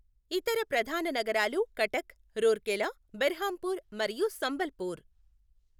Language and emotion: Telugu, neutral